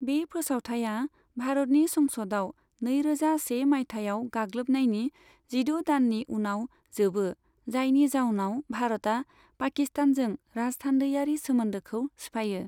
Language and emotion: Bodo, neutral